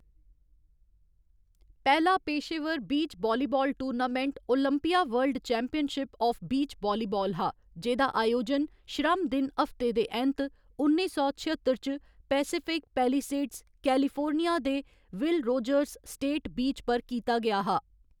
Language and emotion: Dogri, neutral